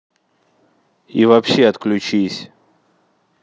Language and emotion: Russian, angry